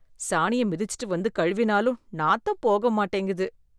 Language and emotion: Tamil, disgusted